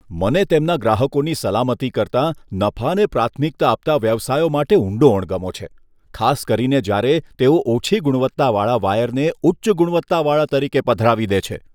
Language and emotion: Gujarati, disgusted